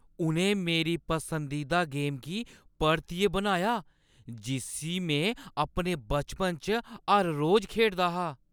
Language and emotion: Dogri, surprised